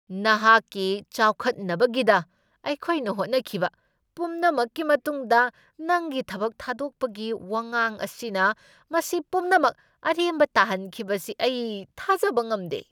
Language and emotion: Manipuri, angry